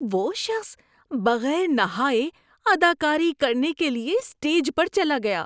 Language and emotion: Urdu, disgusted